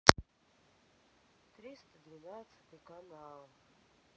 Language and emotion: Russian, sad